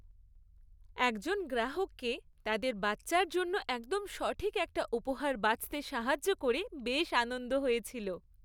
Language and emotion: Bengali, happy